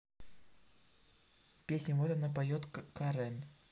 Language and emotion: Russian, neutral